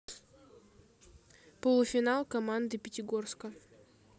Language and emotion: Russian, neutral